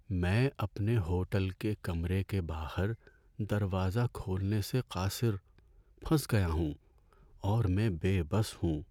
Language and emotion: Urdu, sad